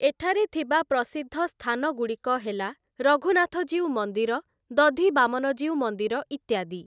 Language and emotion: Odia, neutral